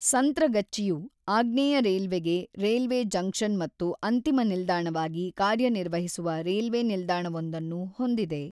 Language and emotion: Kannada, neutral